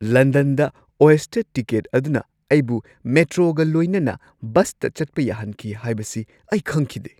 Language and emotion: Manipuri, surprised